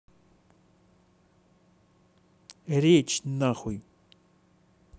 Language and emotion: Russian, angry